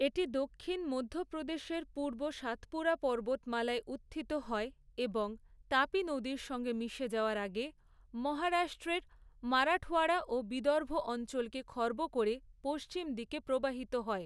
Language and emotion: Bengali, neutral